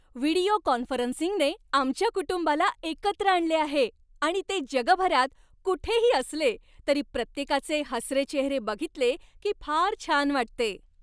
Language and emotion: Marathi, happy